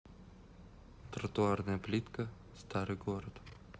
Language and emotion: Russian, neutral